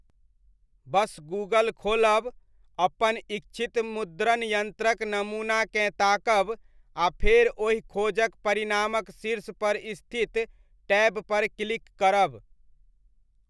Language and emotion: Maithili, neutral